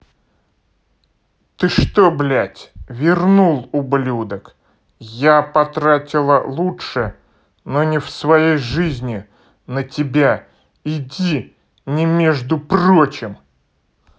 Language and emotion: Russian, angry